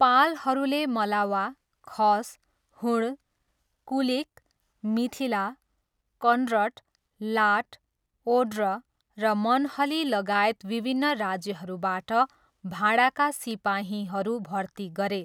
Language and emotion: Nepali, neutral